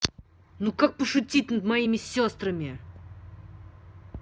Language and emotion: Russian, angry